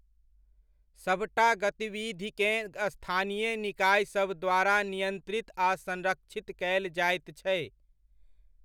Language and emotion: Maithili, neutral